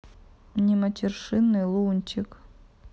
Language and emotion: Russian, neutral